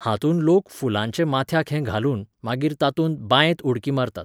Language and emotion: Goan Konkani, neutral